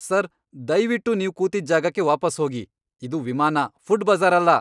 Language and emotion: Kannada, angry